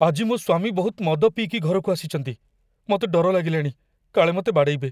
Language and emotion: Odia, fearful